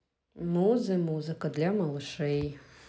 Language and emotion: Russian, neutral